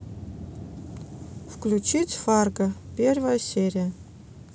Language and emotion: Russian, neutral